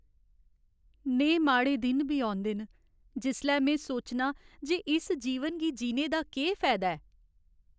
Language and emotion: Dogri, sad